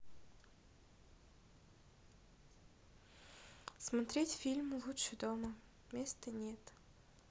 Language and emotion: Russian, neutral